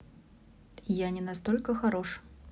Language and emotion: Russian, neutral